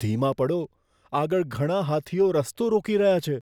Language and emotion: Gujarati, fearful